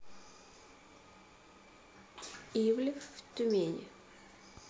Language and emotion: Russian, neutral